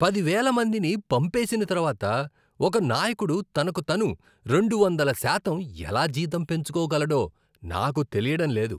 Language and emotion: Telugu, disgusted